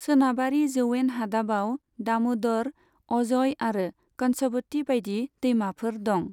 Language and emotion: Bodo, neutral